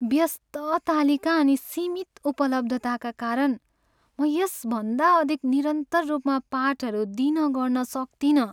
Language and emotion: Nepali, sad